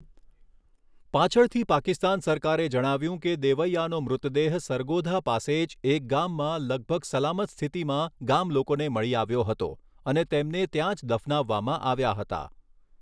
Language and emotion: Gujarati, neutral